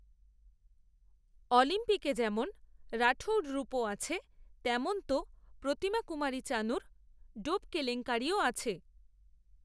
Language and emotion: Bengali, neutral